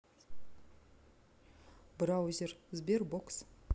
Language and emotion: Russian, neutral